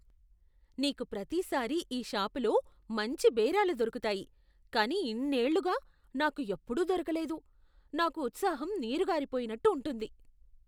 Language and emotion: Telugu, disgusted